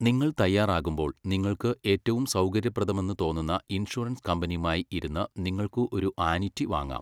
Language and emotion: Malayalam, neutral